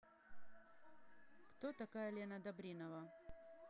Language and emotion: Russian, neutral